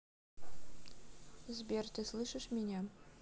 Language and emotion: Russian, neutral